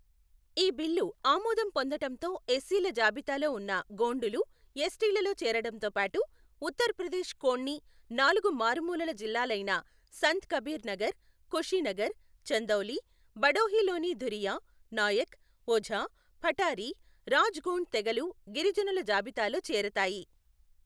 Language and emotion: Telugu, neutral